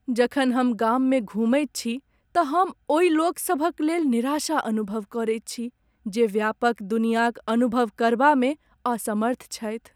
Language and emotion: Maithili, sad